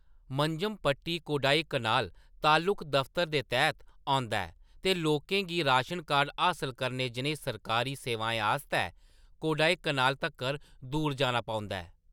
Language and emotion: Dogri, neutral